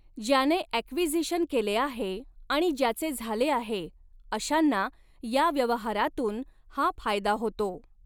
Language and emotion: Marathi, neutral